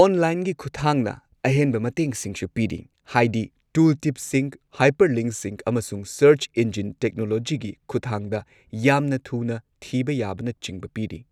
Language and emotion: Manipuri, neutral